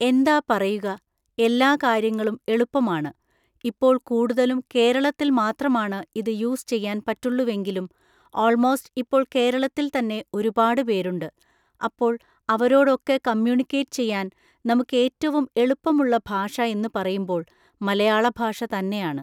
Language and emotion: Malayalam, neutral